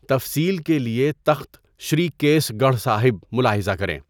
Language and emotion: Urdu, neutral